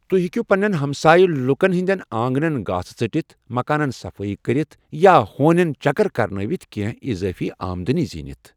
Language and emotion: Kashmiri, neutral